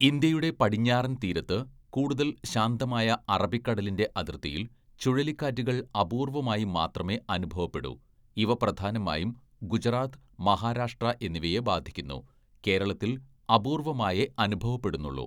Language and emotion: Malayalam, neutral